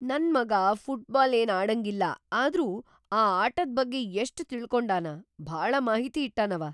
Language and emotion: Kannada, surprised